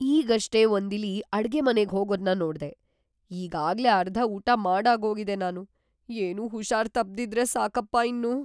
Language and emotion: Kannada, fearful